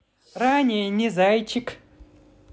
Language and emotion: Russian, positive